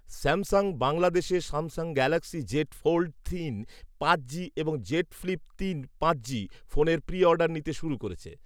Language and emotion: Bengali, neutral